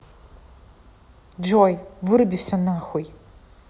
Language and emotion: Russian, angry